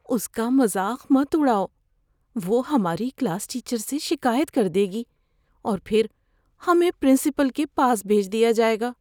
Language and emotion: Urdu, fearful